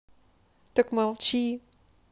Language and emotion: Russian, neutral